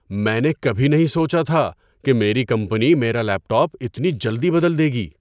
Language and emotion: Urdu, surprised